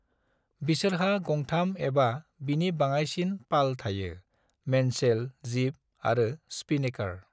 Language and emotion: Bodo, neutral